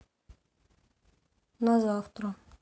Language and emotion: Russian, sad